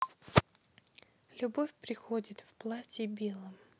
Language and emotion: Russian, sad